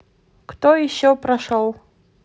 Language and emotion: Russian, neutral